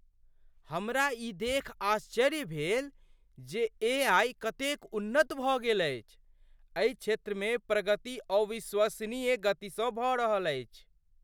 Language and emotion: Maithili, surprised